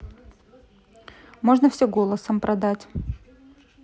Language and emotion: Russian, neutral